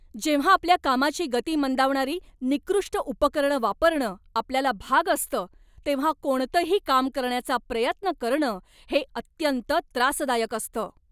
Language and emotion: Marathi, angry